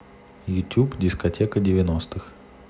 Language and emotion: Russian, neutral